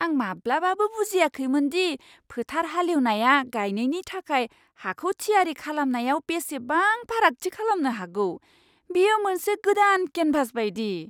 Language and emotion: Bodo, surprised